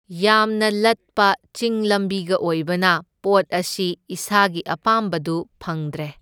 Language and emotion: Manipuri, neutral